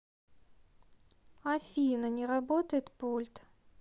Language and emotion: Russian, sad